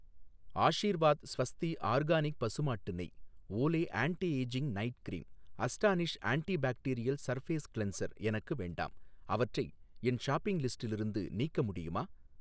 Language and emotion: Tamil, neutral